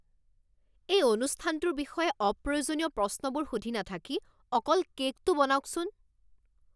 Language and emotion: Assamese, angry